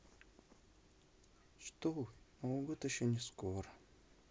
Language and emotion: Russian, sad